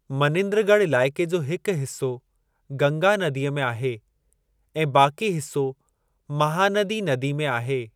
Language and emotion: Sindhi, neutral